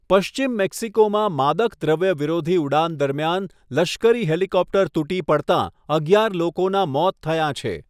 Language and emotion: Gujarati, neutral